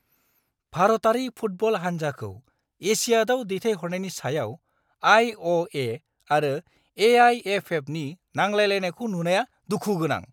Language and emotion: Bodo, angry